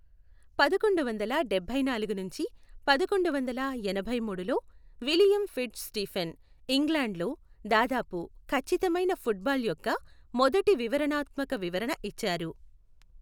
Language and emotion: Telugu, neutral